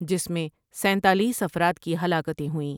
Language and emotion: Urdu, neutral